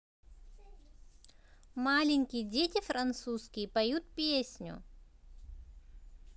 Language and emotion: Russian, positive